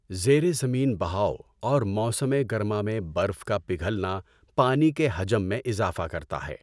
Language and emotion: Urdu, neutral